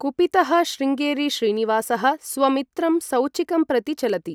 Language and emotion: Sanskrit, neutral